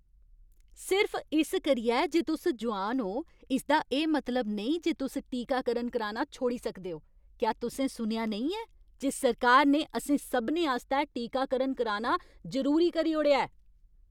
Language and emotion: Dogri, angry